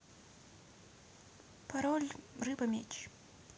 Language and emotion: Russian, neutral